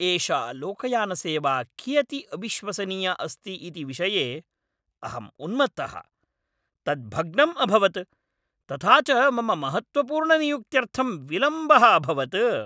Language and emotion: Sanskrit, angry